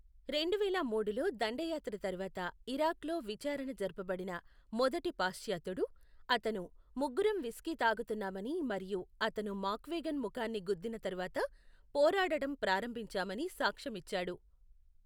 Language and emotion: Telugu, neutral